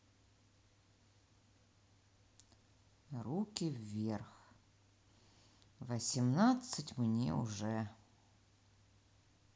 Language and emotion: Russian, neutral